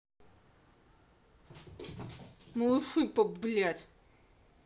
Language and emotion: Russian, angry